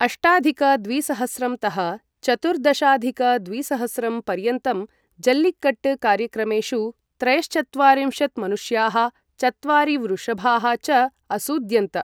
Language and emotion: Sanskrit, neutral